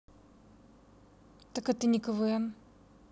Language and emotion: Russian, neutral